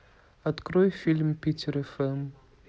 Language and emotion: Russian, neutral